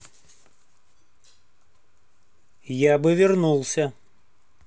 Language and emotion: Russian, neutral